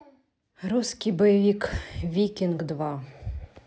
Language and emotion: Russian, neutral